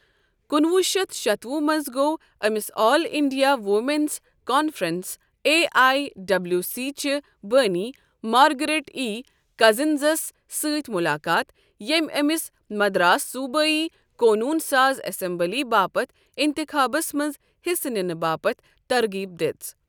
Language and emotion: Kashmiri, neutral